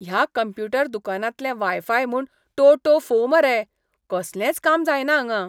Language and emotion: Goan Konkani, disgusted